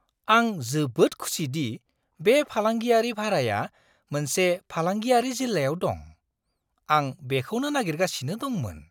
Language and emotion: Bodo, surprised